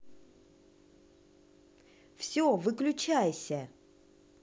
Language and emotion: Russian, angry